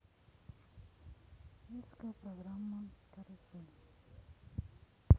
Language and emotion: Russian, sad